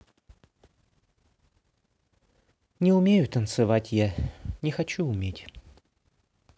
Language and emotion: Russian, sad